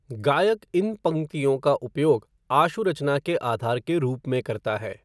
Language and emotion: Hindi, neutral